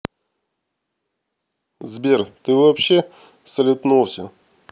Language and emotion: Russian, neutral